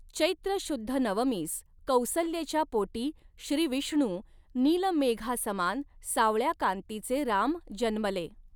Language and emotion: Marathi, neutral